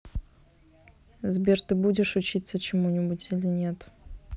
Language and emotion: Russian, neutral